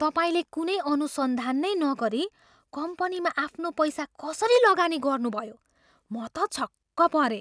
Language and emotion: Nepali, surprised